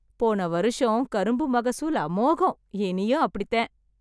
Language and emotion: Tamil, happy